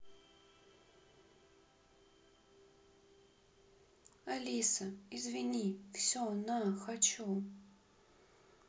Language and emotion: Russian, sad